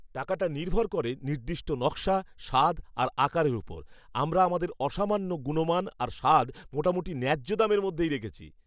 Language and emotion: Bengali, happy